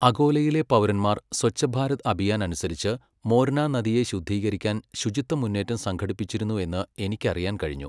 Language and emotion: Malayalam, neutral